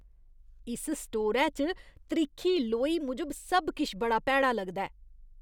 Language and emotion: Dogri, disgusted